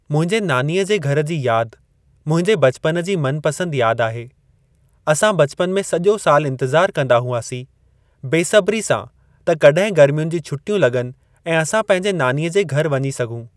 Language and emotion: Sindhi, neutral